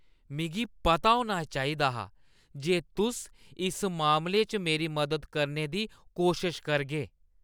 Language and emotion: Dogri, disgusted